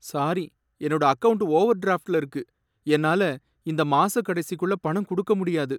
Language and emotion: Tamil, sad